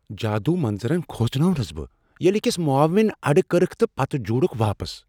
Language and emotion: Kashmiri, surprised